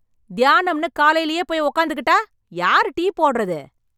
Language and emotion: Tamil, angry